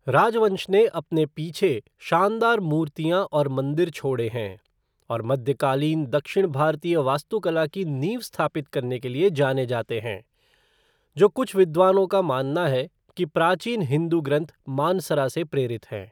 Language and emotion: Hindi, neutral